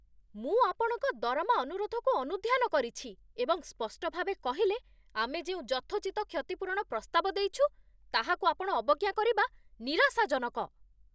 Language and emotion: Odia, angry